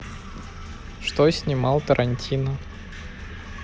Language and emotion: Russian, neutral